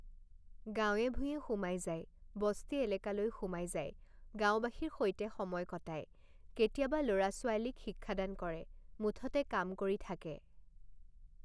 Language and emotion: Assamese, neutral